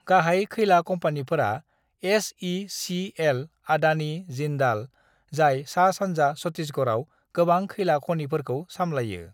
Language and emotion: Bodo, neutral